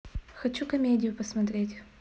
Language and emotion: Russian, neutral